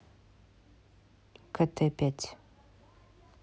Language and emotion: Russian, neutral